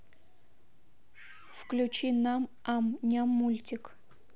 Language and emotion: Russian, neutral